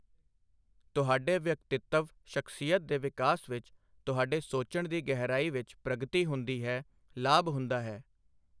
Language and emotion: Punjabi, neutral